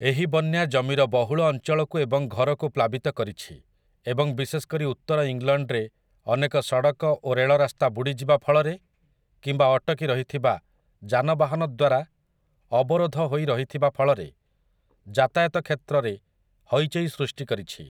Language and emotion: Odia, neutral